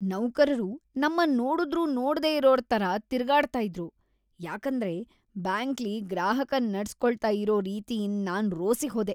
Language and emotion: Kannada, disgusted